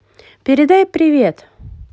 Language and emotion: Russian, positive